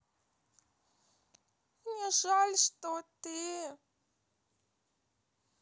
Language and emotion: Russian, sad